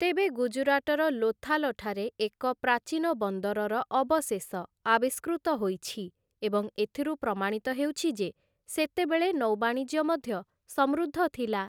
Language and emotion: Odia, neutral